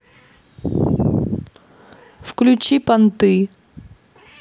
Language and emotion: Russian, neutral